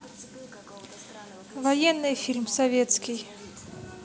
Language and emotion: Russian, neutral